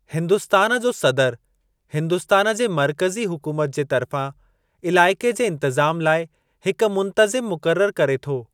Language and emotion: Sindhi, neutral